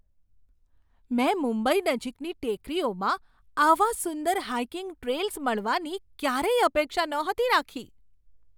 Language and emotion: Gujarati, surprised